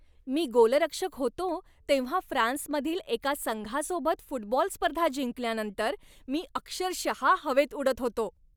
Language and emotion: Marathi, happy